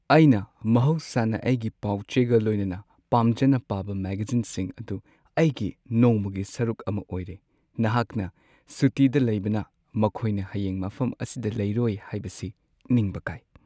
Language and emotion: Manipuri, sad